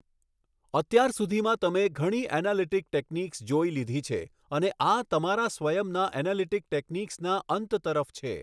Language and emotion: Gujarati, neutral